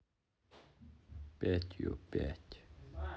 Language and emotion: Russian, sad